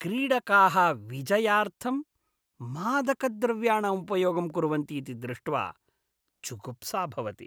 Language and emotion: Sanskrit, disgusted